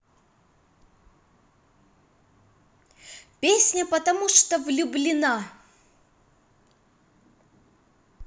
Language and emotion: Russian, positive